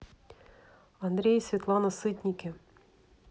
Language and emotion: Russian, neutral